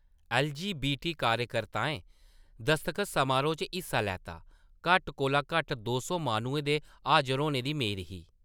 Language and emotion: Dogri, neutral